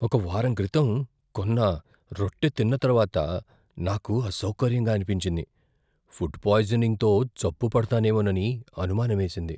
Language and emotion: Telugu, fearful